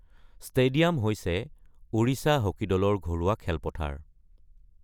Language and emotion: Assamese, neutral